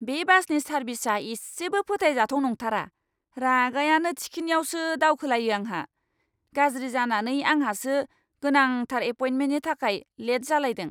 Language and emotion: Bodo, angry